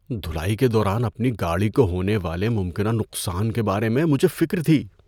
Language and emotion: Urdu, fearful